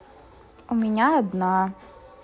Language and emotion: Russian, sad